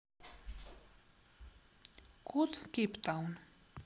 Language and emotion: Russian, neutral